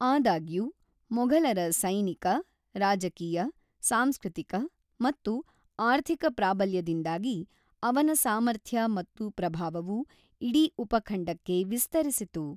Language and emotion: Kannada, neutral